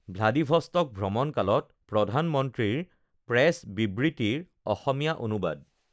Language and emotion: Assamese, neutral